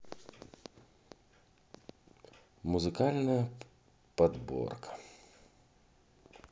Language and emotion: Russian, neutral